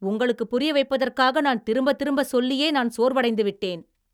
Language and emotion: Tamil, angry